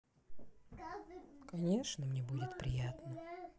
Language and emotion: Russian, sad